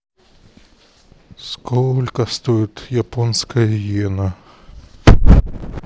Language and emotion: Russian, neutral